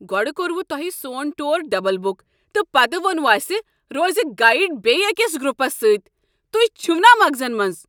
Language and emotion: Kashmiri, angry